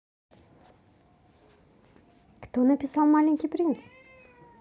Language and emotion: Russian, positive